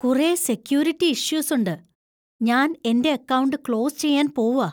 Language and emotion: Malayalam, fearful